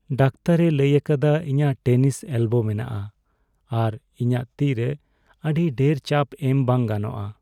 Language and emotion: Santali, sad